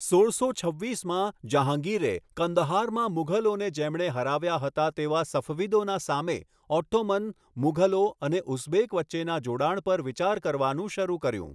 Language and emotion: Gujarati, neutral